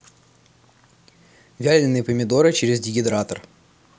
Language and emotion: Russian, neutral